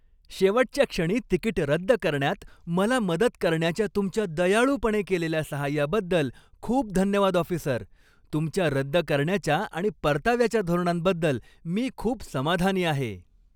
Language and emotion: Marathi, happy